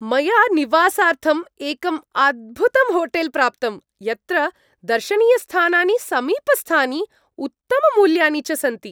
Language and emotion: Sanskrit, happy